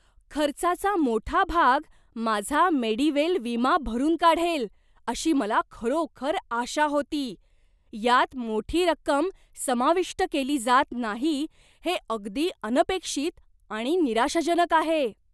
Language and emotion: Marathi, surprised